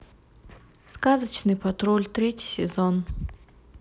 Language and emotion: Russian, neutral